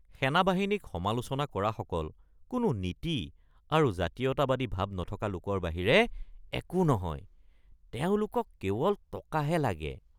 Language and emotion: Assamese, disgusted